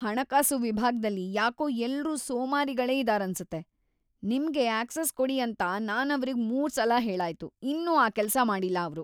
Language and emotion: Kannada, disgusted